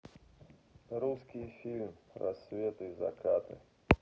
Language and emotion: Russian, neutral